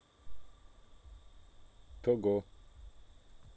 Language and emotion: Russian, neutral